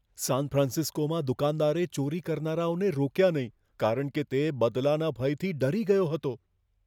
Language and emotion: Gujarati, fearful